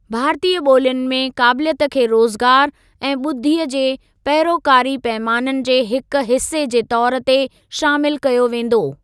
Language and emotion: Sindhi, neutral